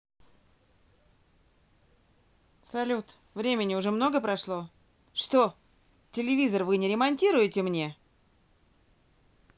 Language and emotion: Russian, angry